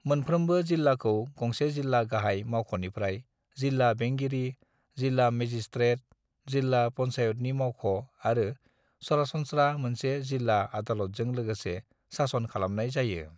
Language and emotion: Bodo, neutral